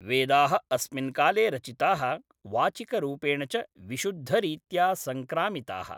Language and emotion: Sanskrit, neutral